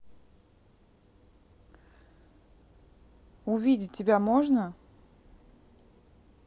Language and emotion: Russian, neutral